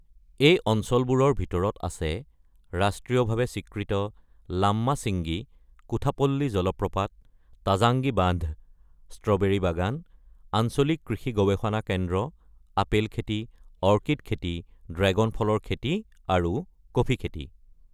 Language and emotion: Assamese, neutral